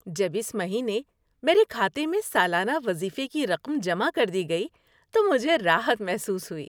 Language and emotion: Urdu, happy